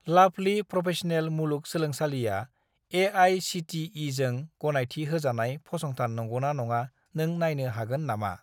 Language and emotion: Bodo, neutral